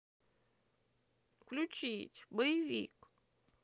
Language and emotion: Russian, sad